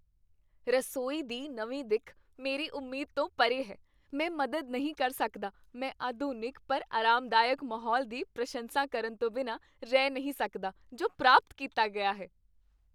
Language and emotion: Punjabi, happy